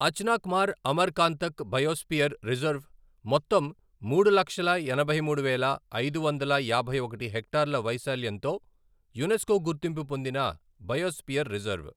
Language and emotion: Telugu, neutral